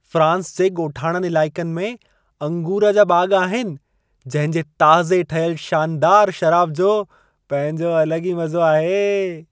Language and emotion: Sindhi, happy